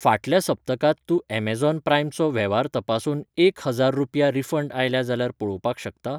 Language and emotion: Goan Konkani, neutral